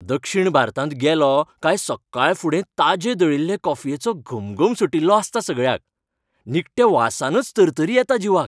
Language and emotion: Goan Konkani, happy